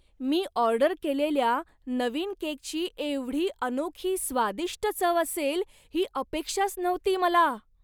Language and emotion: Marathi, surprised